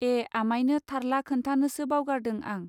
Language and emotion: Bodo, neutral